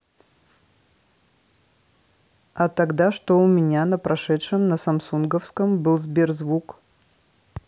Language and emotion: Russian, neutral